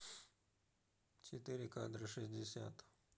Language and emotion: Russian, neutral